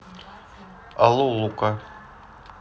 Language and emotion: Russian, neutral